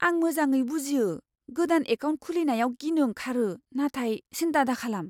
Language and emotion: Bodo, fearful